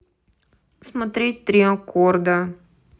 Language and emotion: Russian, neutral